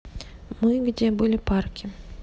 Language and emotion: Russian, neutral